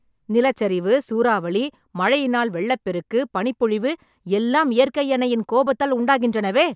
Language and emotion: Tamil, angry